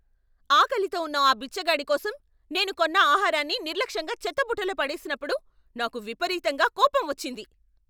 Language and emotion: Telugu, angry